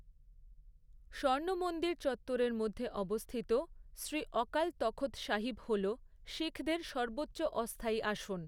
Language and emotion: Bengali, neutral